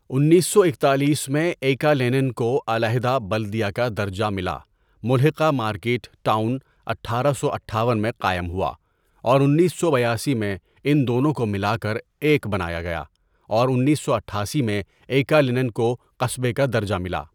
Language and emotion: Urdu, neutral